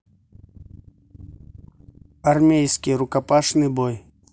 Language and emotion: Russian, neutral